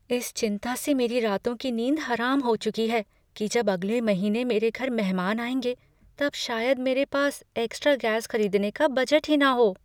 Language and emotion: Hindi, fearful